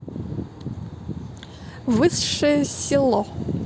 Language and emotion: Russian, neutral